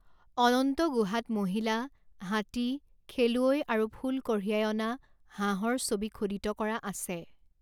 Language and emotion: Assamese, neutral